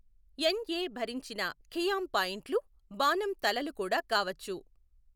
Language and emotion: Telugu, neutral